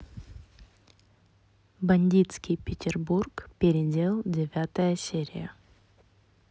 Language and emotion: Russian, neutral